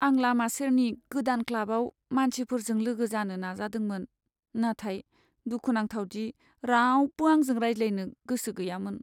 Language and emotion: Bodo, sad